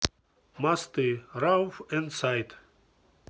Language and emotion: Russian, neutral